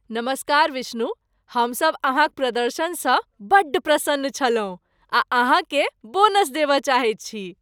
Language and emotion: Maithili, happy